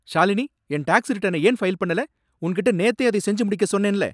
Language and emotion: Tamil, angry